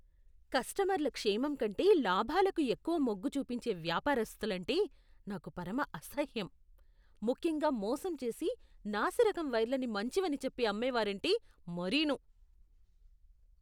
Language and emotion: Telugu, disgusted